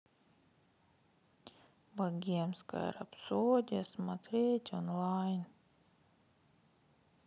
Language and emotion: Russian, sad